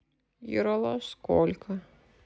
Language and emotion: Russian, sad